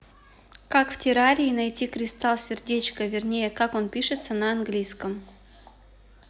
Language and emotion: Russian, neutral